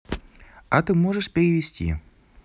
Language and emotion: Russian, positive